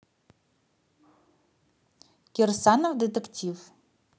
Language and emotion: Russian, neutral